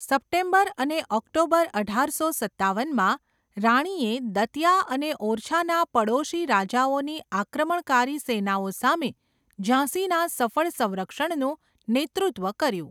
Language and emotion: Gujarati, neutral